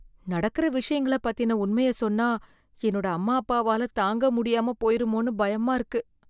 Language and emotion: Tamil, fearful